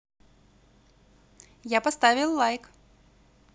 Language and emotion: Russian, positive